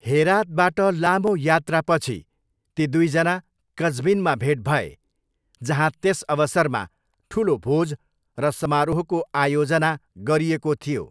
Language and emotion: Nepali, neutral